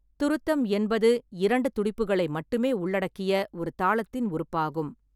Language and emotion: Tamil, neutral